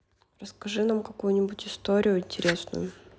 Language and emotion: Russian, neutral